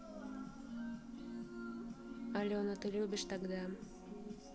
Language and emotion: Russian, neutral